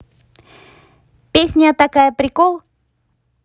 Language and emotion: Russian, positive